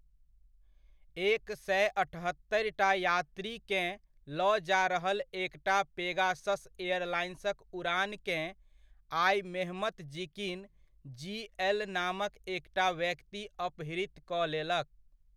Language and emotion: Maithili, neutral